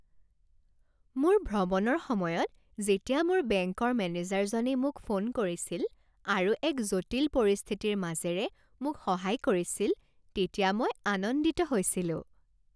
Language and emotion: Assamese, happy